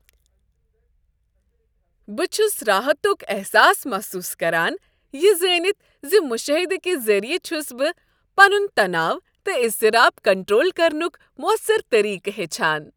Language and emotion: Kashmiri, happy